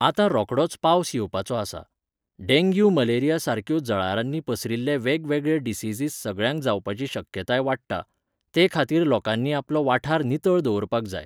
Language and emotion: Goan Konkani, neutral